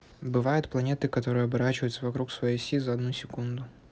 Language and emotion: Russian, neutral